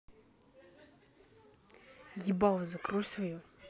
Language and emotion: Russian, angry